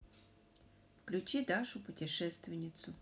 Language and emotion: Russian, neutral